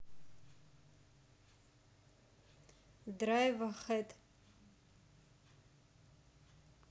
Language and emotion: Russian, neutral